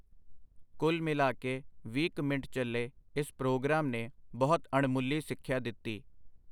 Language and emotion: Punjabi, neutral